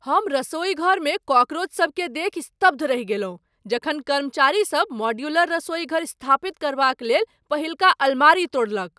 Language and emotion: Maithili, surprised